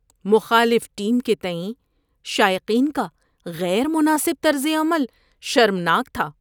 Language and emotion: Urdu, disgusted